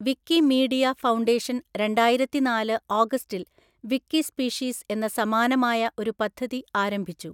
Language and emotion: Malayalam, neutral